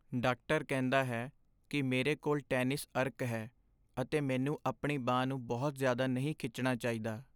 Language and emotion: Punjabi, sad